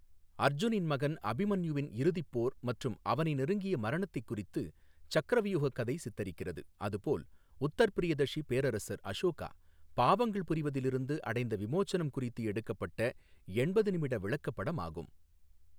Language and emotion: Tamil, neutral